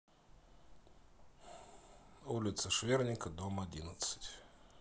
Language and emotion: Russian, sad